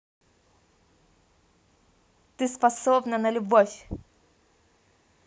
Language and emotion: Russian, positive